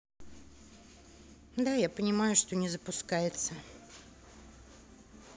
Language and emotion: Russian, sad